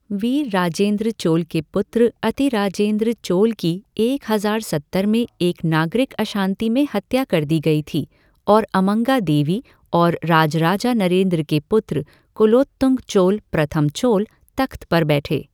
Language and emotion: Hindi, neutral